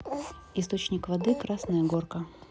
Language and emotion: Russian, neutral